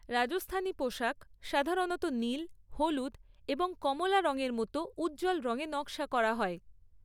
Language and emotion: Bengali, neutral